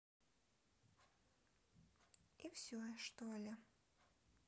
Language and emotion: Russian, neutral